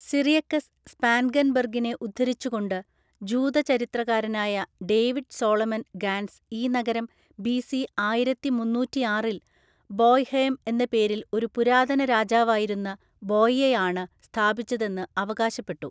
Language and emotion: Malayalam, neutral